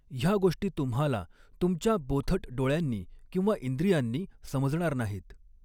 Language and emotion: Marathi, neutral